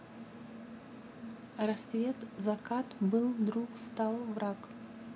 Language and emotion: Russian, neutral